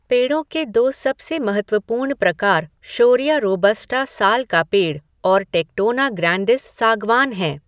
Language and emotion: Hindi, neutral